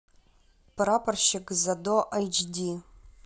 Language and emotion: Russian, neutral